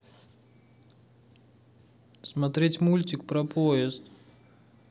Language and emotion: Russian, sad